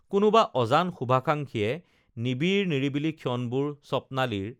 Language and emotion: Assamese, neutral